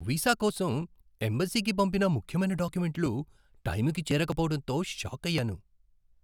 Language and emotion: Telugu, surprised